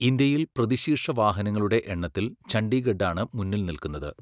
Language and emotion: Malayalam, neutral